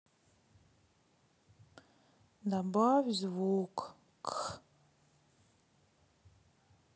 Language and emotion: Russian, sad